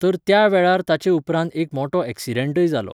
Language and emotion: Goan Konkani, neutral